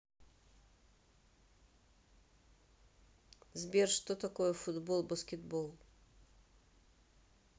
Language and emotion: Russian, neutral